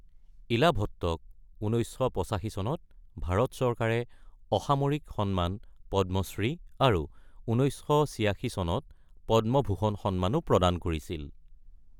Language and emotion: Assamese, neutral